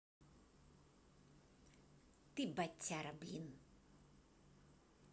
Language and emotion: Russian, angry